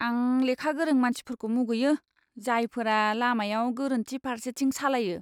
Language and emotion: Bodo, disgusted